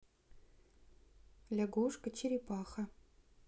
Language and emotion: Russian, neutral